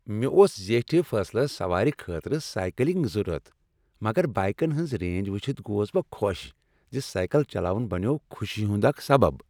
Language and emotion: Kashmiri, happy